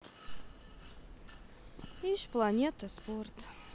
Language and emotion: Russian, sad